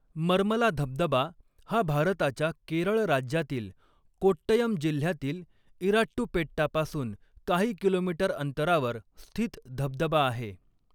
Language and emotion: Marathi, neutral